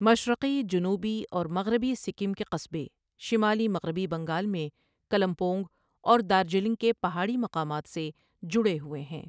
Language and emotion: Urdu, neutral